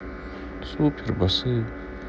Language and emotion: Russian, sad